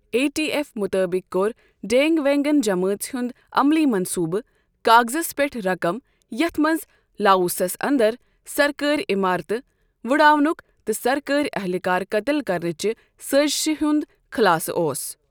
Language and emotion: Kashmiri, neutral